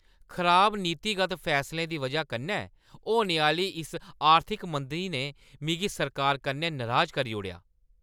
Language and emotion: Dogri, angry